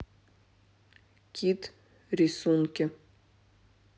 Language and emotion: Russian, neutral